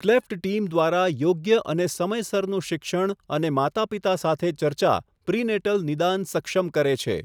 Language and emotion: Gujarati, neutral